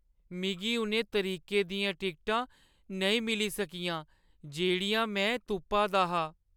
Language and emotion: Dogri, sad